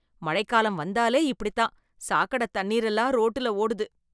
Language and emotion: Tamil, disgusted